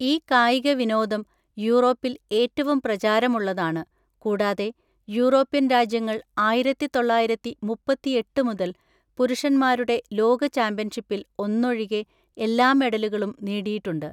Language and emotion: Malayalam, neutral